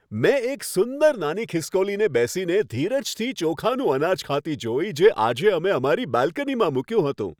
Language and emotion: Gujarati, happy